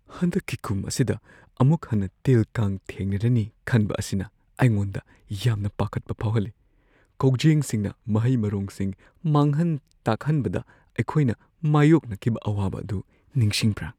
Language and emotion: Manipuri, fearful